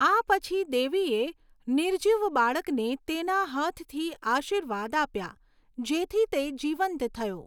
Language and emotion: Gujarati, neutral